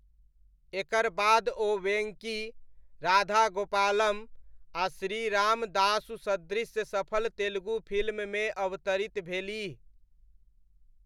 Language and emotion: Maithili, neutral